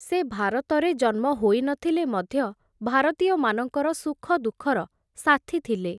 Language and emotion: Odia, neutral